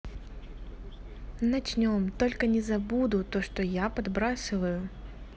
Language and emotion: Russian, neutral